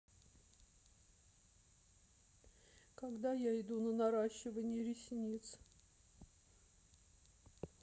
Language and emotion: Russian, sad